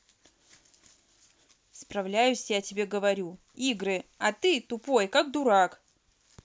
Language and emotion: Russian, angry